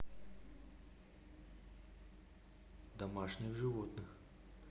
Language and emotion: Russian, neutral